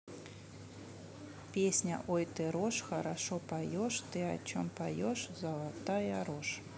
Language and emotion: Russian, neutral